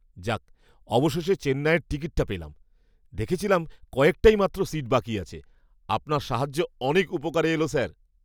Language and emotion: Bengali, surprised